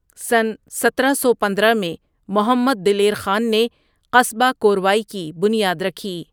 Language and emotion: Urdu, neutral